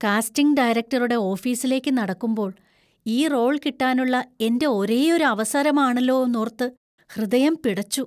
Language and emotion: Malayalam, fearful